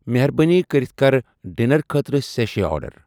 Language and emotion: Kashmiri, neutral